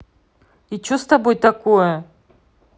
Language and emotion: Russian, angry